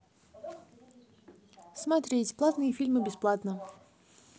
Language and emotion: Russian, neutral